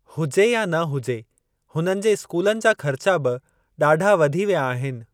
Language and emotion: Sindhi, neutral